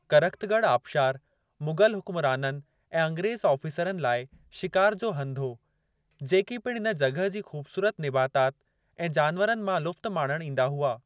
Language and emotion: Sindhi, neutral